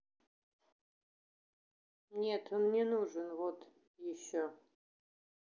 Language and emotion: Russian, neutral